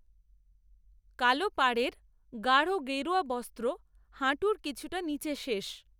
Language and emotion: Bengali, neutral